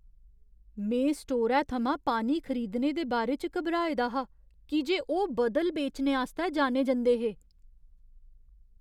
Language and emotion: Dogri, fearful